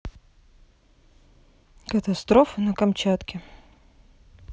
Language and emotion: Russian, neutral